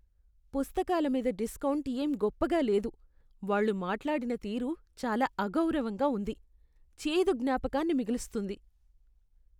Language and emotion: Telugu, disgusted